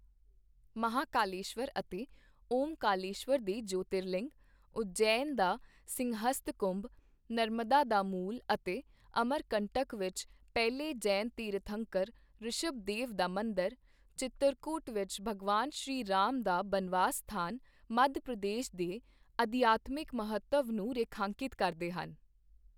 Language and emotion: Punjabi, neutral